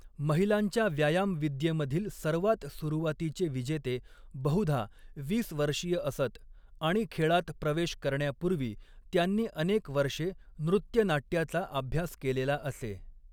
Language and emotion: Marathi, neutral